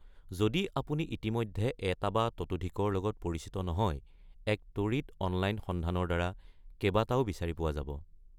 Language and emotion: Assamese, neutral